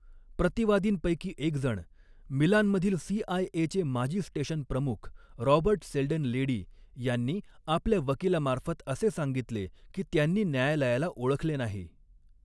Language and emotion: Marathi, neutral